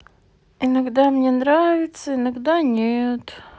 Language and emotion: Russian, sad